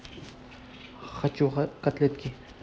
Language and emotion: Russian, neutral